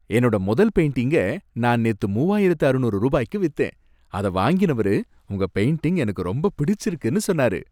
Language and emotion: Tamil, happy